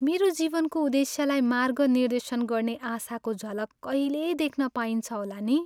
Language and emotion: Nepali, sad